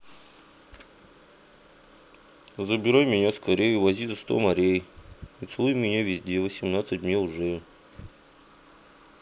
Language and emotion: Russian, neutral